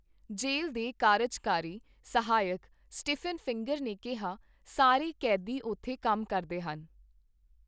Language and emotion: Punjabi, neutral